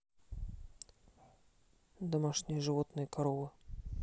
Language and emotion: Russian, neutral